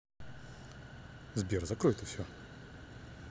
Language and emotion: Russian, neutral